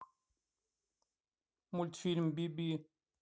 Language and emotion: Russian, neutral